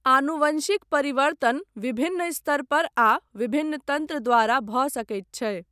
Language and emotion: Maithili, neutral